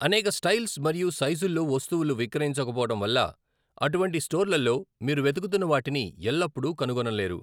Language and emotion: Telugu, neutral